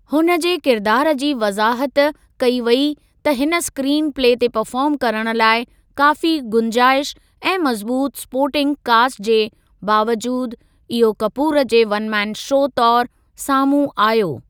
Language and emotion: Sindhi, neutral